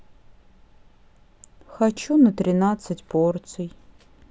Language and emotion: Russian, sad